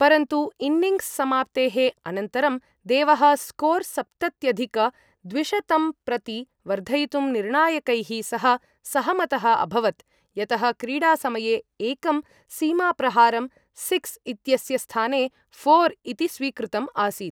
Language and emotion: Sanskrit, neutral